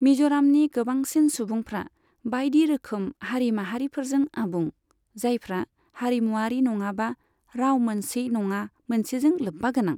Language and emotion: Bodo, neutral